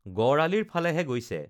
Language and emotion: Assamese, neutral